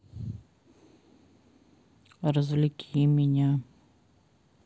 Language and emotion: Russian, sad